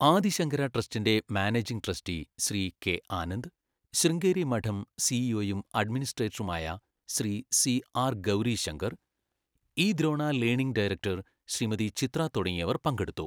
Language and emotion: Malayalam, neutral